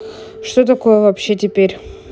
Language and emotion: Russian, neutral